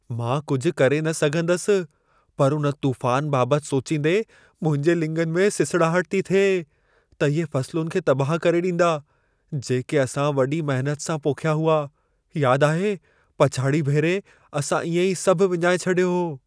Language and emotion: Sindhi, fearful